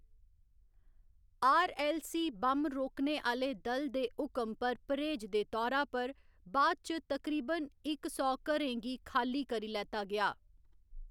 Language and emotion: Dogri, neutral